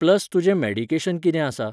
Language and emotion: Goan Konkani, neutral